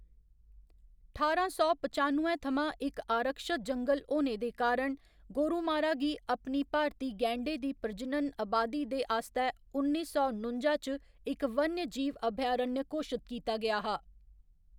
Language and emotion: Dogri, neutral